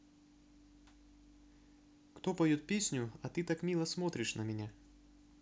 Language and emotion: Russian, neutral